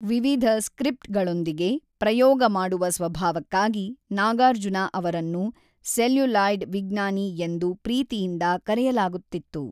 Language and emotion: Kannada, neutral